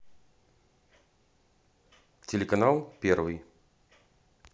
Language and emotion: Russian, neutral